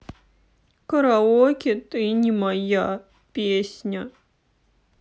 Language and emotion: Russian, sad